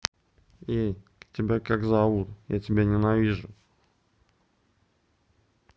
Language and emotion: Russian, neutral